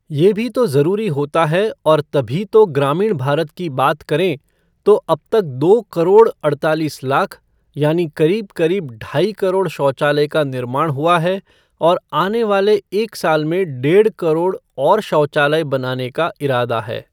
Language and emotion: Hindi, neutral